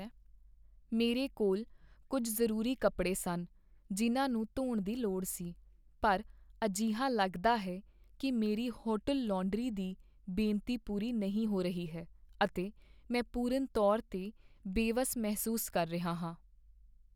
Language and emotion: Punjabi, sad